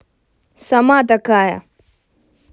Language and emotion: Russian, angry